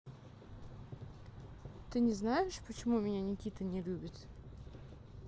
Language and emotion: Russian, neutral